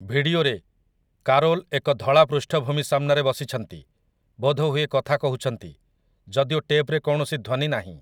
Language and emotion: Odia, neutral